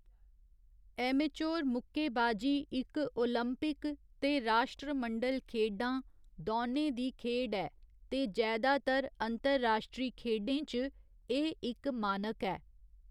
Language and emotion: Dogri, neutral